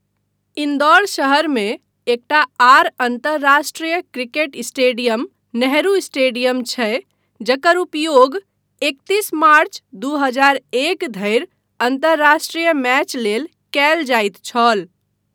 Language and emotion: Maithili, neutral